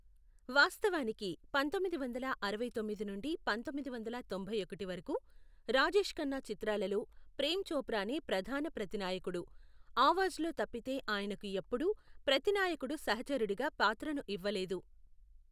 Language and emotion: Telugu, neutral